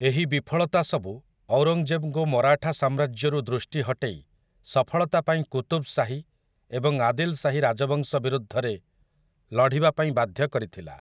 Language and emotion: Odia, neutral